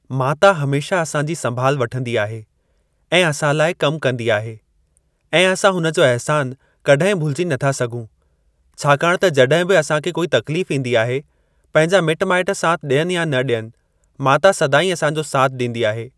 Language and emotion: Sindhi, neutral